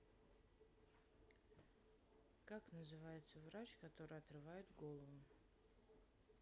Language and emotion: Russian, sad